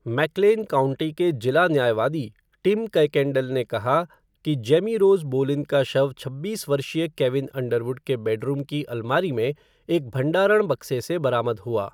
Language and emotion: Hindi, neutral